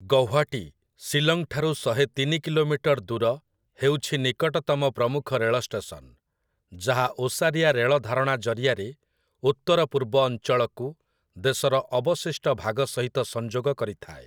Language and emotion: Odia, neutral